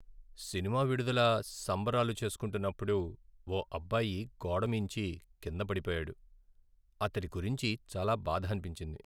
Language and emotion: Telugu, sad